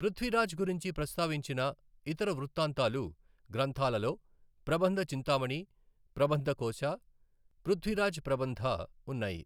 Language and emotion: Telugu, neutral